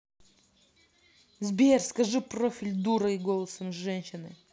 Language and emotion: Russian, angry